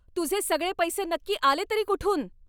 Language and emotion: Marathi, angry